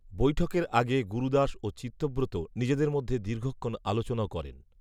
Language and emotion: Bengali, neutral